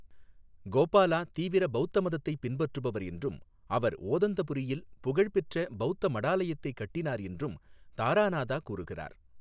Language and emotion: Tamil, neutral